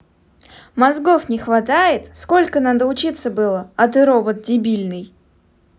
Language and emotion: Russian, angry